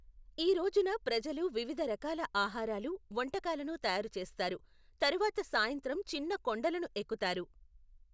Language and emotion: Telugu, neutral